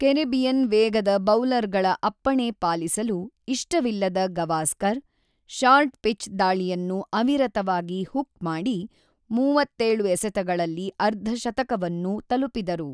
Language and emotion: Kannada, neutral